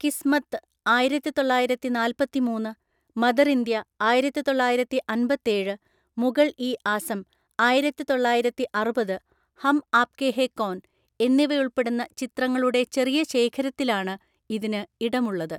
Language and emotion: Malayalam, neutral